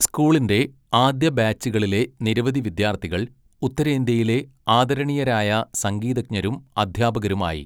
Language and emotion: Malayalam, neutral